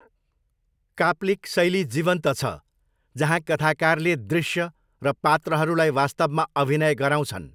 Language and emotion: Nepali, neutral